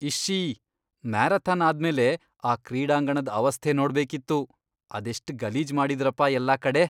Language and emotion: Kannada, disgusted